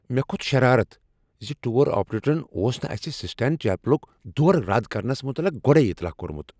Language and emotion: Kashmiri, angry